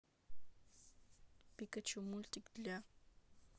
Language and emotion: Russian, neutral